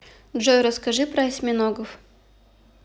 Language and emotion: Russian, neutral